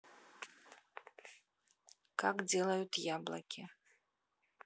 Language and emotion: Russian, neutral